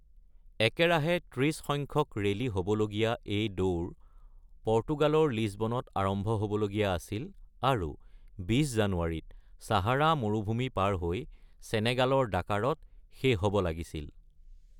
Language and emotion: Assamese, neutral